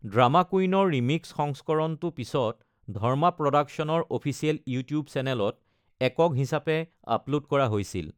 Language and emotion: Assamese, neutral